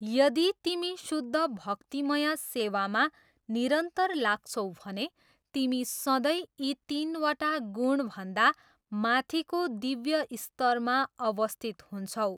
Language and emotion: Nepali, neutral